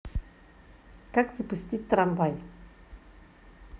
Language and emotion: Russian, positive